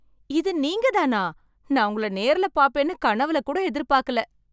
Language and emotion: Tamil, surprised